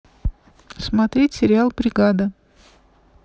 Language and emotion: Russian, neutral